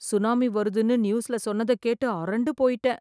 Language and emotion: Tamil, fearful